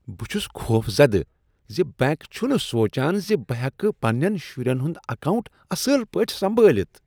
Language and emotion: Kashmiri, disgusted